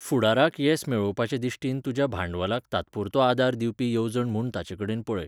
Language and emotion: Goan Konkani, neutral